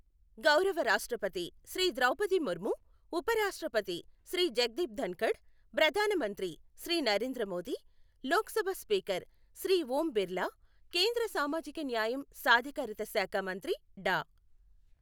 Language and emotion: Telugu, neutral